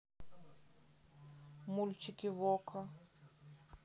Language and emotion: Russian, neutral